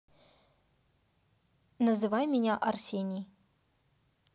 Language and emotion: Russian, neutral